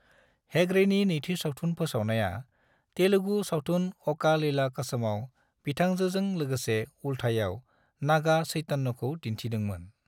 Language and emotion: Bodo, neutral